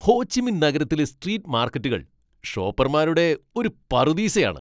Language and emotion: Malayalam, happy